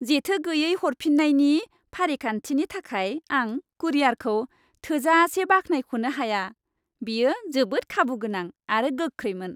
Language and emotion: Bodo, happy